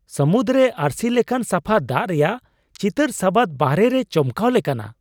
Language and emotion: Santali, surprised